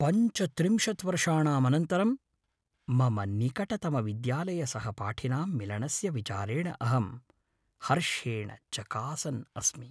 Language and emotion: Sanskrit, happy